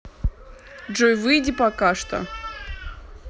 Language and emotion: Russian, neutral